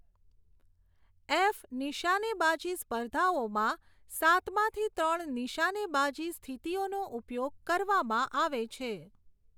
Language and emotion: Gujarati, neutral